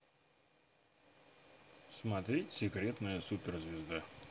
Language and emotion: Russian, neutral